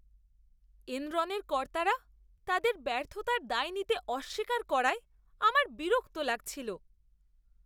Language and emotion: Bengali, disgusted